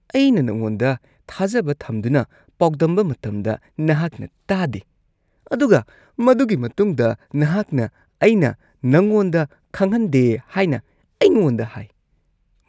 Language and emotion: Manipuri, disgusted